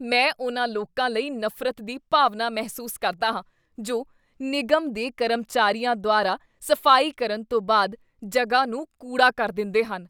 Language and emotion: Punjabi, disgusted